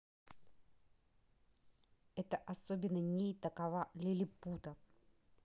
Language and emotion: Russian, neutral